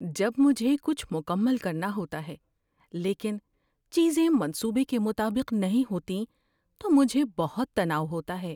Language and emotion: Urdu, fearful